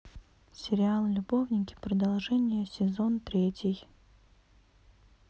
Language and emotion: Russian, neutral